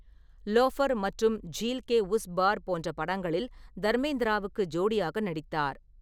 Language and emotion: Tamil, neutral